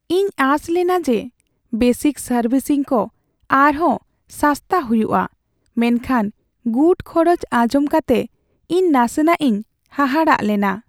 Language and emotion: Santali, sad